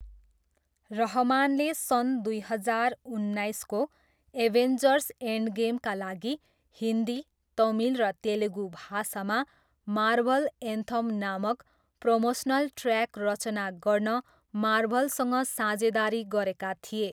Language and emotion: Nepali, neutral